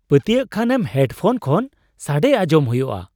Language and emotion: Santali, surprised